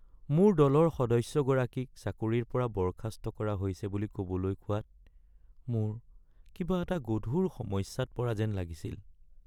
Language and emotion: Assamese, sad